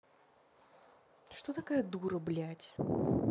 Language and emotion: Russian, angry